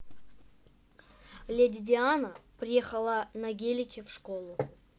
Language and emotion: Russian, neutral